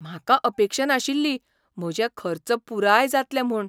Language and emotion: Goan Konkani, surprised